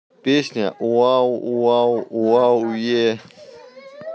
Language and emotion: Russian, neutral